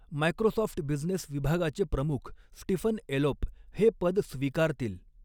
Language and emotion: Marathi, neutral